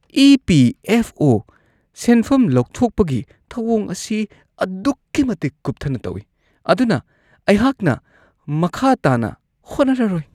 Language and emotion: Manipuri, disgusted